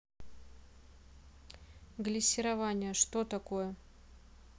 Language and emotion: Russian, neutral